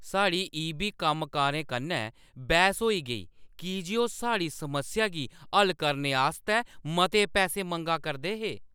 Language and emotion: Dogri, angry